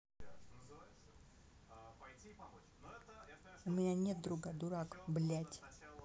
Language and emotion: Russian, angry